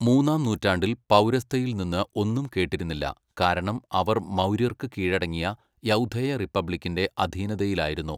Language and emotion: Malayalam, neutral